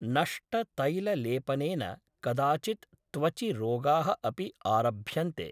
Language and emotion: Sanskrit, neutral